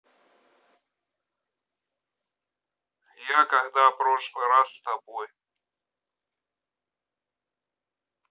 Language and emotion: Russian, neutral